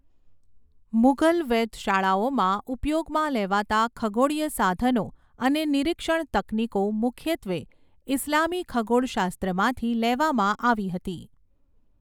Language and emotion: Gujarati, neutral